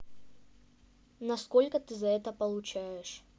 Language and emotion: Russian, neutral